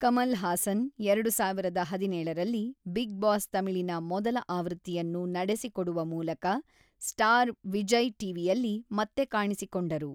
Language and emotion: Kannada, neutral